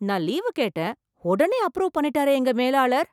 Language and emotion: Tamil, surprised